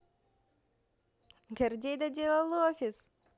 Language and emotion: Russian, positive